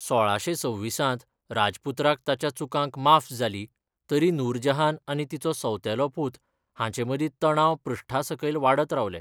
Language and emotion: Goan Konkani, neutral